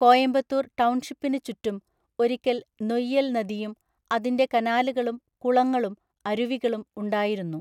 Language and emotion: Malayalam, neutral